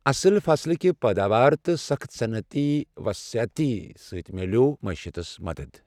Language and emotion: Kashmiri, neutral